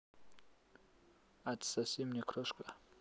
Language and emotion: Russian, neutral